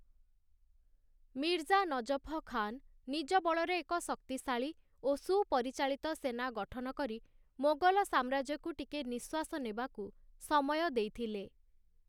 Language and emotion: Odia, neutral